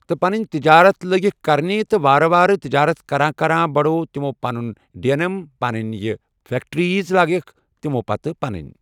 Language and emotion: Kashmiri, neutral